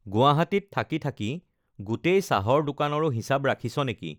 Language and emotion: Assamese, neutral